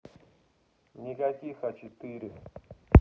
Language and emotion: Russian, neutral